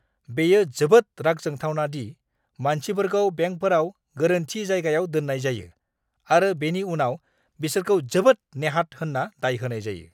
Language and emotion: Bodo, angry